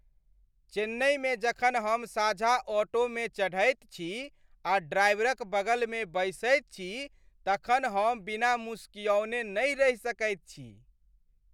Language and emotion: Maithili, happy